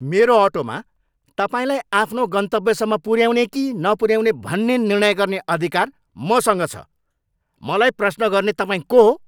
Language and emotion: Nepali, angry